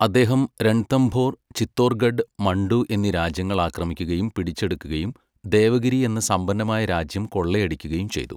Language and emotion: Malayalam, neutral